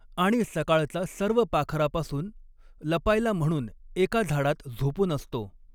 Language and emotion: Marathi, neutral